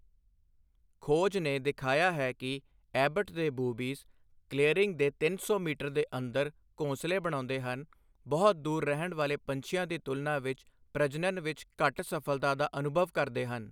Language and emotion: Punjabi, neutral